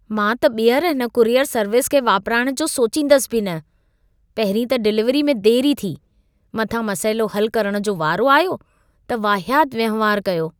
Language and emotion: Sindhi, disgusted